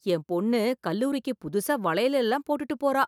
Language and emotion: Tamil, surprised